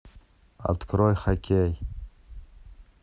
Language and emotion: Russian, neutral